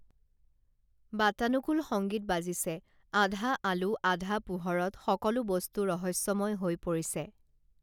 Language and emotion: Assamese, neutral